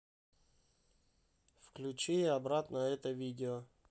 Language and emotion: Russian, neutral